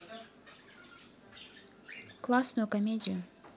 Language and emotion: Russian, neutral